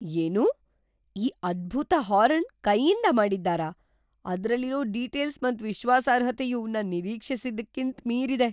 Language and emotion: Kannada, surprised